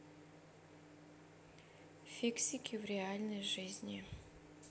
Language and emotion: Russian, neutral